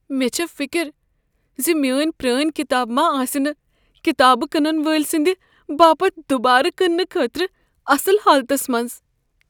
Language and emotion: Kashmiri, fearful